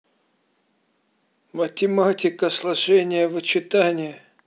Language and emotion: Russian, angry